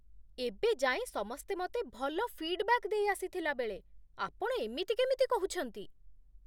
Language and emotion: Odia, surprised